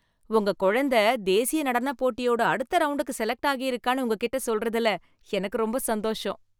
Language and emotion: Tamil, happy